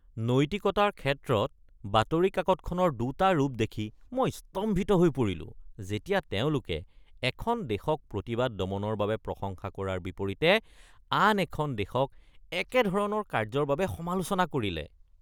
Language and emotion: Assamese, disgusted